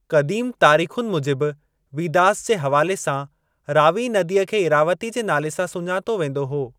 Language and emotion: Sindhi, neutral